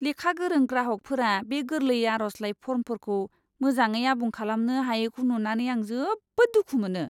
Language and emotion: Bodo, disgusted